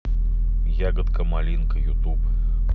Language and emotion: Russian, neutral